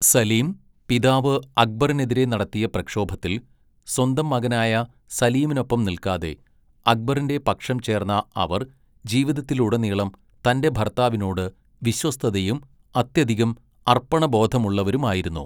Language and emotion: Malayalam, neutral